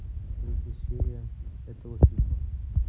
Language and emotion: Russian, neutral